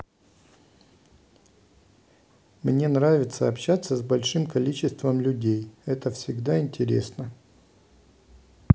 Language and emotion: Russian, neutral